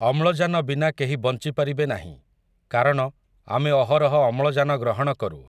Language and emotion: Odia, neutral